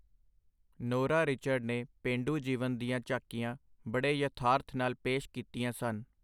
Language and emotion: Punjabi, neutral